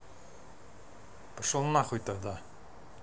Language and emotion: Russian, angry